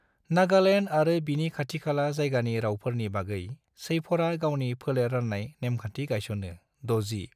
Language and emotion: Bodo, neutral